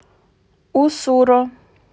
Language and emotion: Russian, neutral